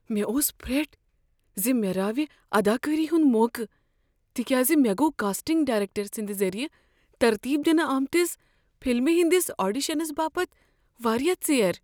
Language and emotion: Kashmiri, fearful